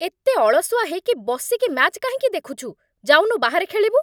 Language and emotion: Odia, angry